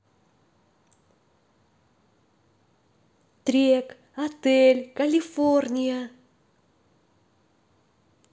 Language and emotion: Russian, positive